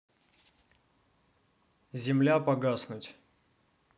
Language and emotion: Russian, neutral